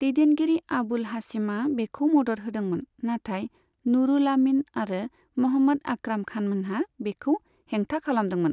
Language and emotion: Bodo, neutral